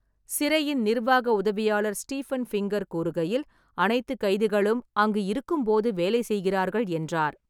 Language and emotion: Tamil, neutral